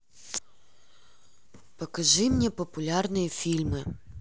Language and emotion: Russian, neutral